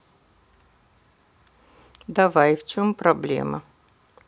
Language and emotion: Russian, neutral